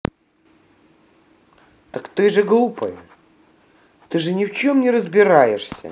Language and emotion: Russian, angry